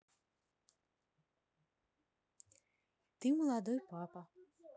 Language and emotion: Russian, neutral